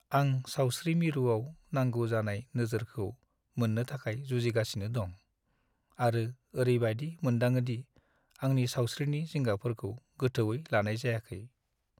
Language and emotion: Bodo, sad